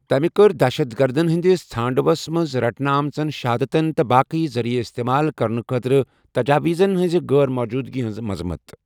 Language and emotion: Kashmiri, neutral